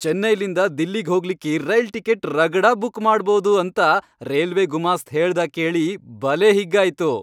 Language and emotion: Kannada, happy